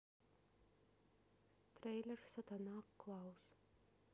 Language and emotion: Russian, neutral